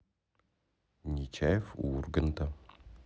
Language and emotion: Russian, neutral